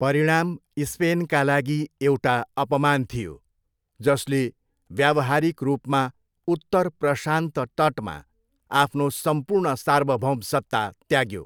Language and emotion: Nepali, neutral